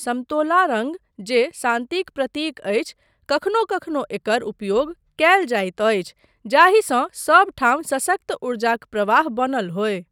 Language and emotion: Maithili, neutral